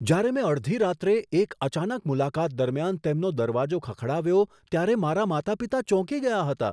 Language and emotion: Gujarati, surprised